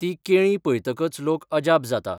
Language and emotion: Goan Konkani, neutral